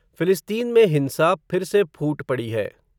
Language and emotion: Hindi, neutral